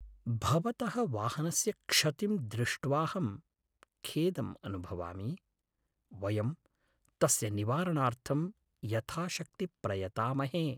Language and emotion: Sanskrit, sad